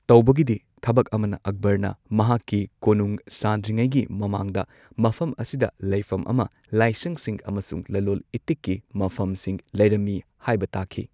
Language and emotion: Manipuri, neutral